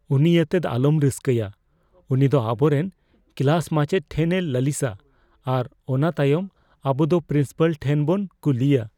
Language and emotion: Santali, fearful